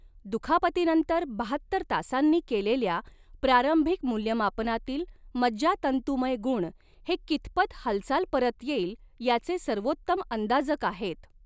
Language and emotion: Marathi, neutral